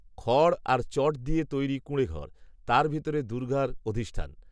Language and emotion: Bengali, neutral